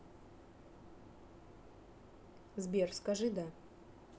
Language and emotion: Russian, neutral